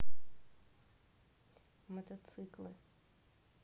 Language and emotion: Russian, neutral